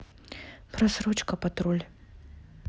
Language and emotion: Russian, neutral